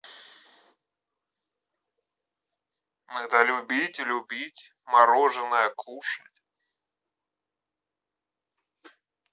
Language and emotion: Russian, neutral